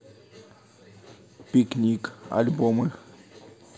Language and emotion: Russian, neutral